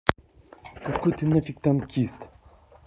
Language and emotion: Russian, angry